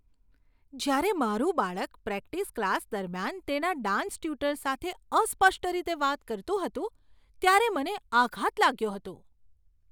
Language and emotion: Gujarati, surprised